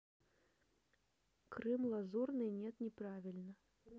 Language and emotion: Russian, neutral